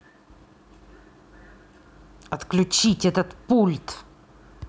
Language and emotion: Russian, angry